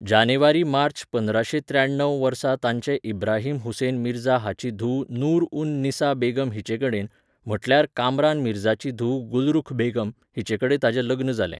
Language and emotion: Goan Konkani, neutral